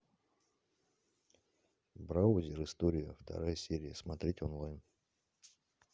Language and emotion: Russian, neutral